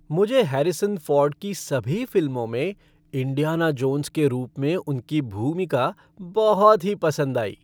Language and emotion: Hindi, happy